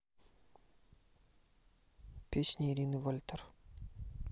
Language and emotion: Russian, neutral